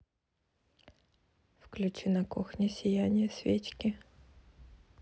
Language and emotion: Russian, neutral